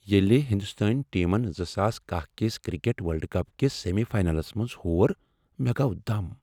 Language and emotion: Kashmiri, sad